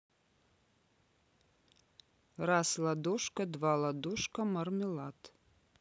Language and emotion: Russian, neutral